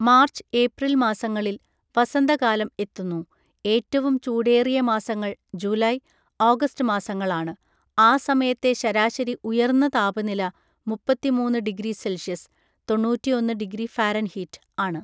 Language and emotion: Malayalam, neutral